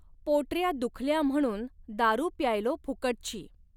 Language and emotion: Marathi, neutral